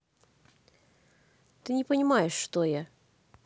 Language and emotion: Russian, neutral